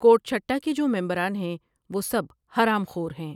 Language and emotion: Urdu, neutral